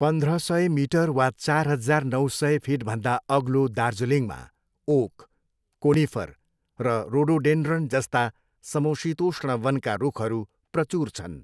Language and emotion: Nepali, neutral